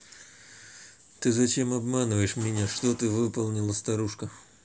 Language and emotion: Russian, neutral